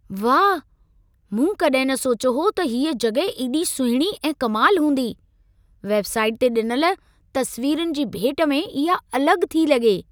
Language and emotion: Sindhi, surprised